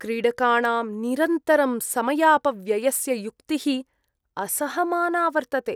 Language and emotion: Sanskrit, disgusted